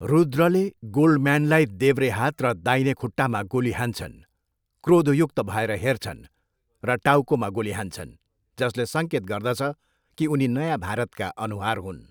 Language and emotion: Nepali, neutral